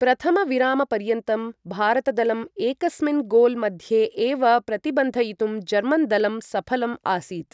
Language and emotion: Sanskrit, neutral